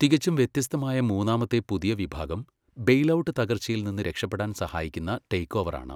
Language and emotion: Malayalam, neutral